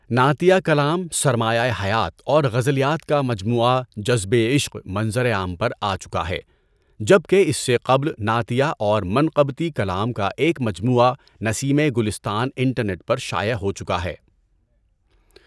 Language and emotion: Urdu, neutral